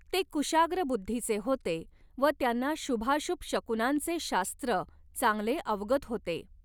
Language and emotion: Marathi, neutral